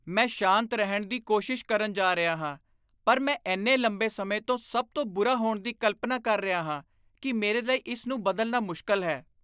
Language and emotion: Punjabi, disgusted